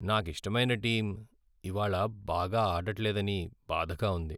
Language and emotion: Telugu, sad